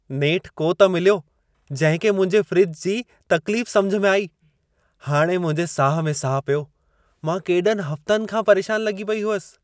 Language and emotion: Sindhi, happy